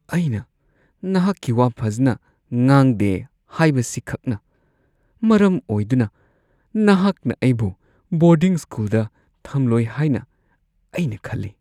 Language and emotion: Manipuri, fearful